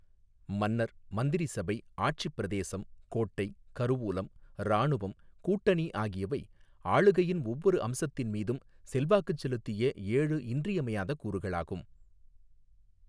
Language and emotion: Tamil, neutral